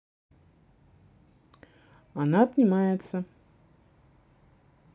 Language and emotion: Russian, neutral